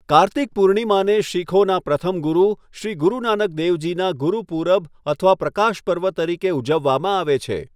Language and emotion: Gujarati, neutral